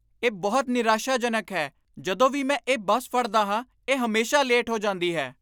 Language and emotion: Punjabi, angry